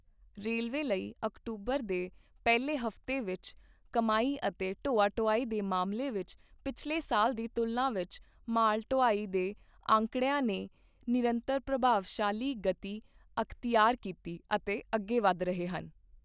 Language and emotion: Punjabi, neutral